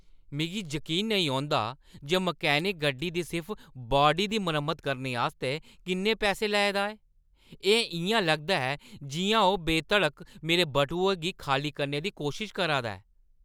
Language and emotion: Dogri, angry